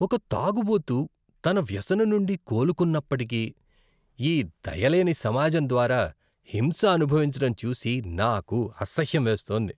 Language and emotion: Telugu, disgusted